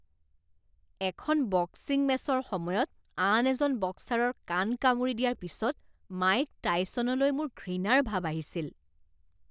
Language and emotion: Assamese, disgusted